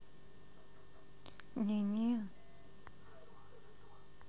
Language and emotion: Russian, neutral